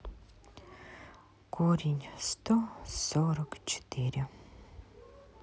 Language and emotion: Russian, sad